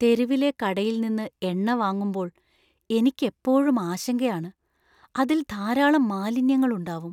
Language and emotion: Malayalam, fearful